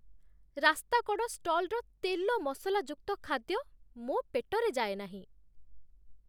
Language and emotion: Odia, disgusted